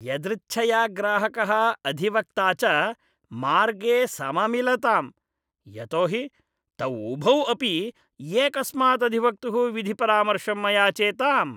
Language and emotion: Sanskrit, disgusted